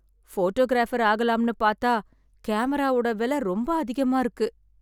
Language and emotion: Tamil, sad